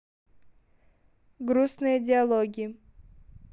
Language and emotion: Russian, neutral